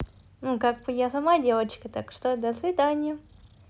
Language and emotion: Russian, positive